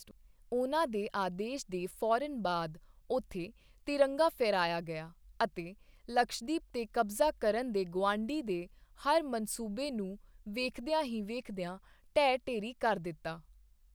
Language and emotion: Punjabi, neutral